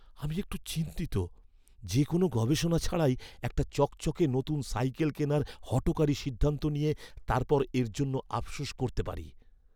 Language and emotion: Bengali, fearful